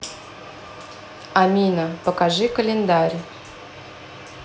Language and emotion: Russian, neutral